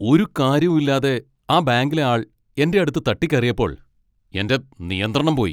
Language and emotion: Malayalam, angry